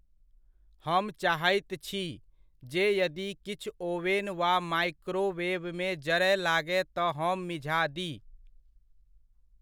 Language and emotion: Maithili, neutral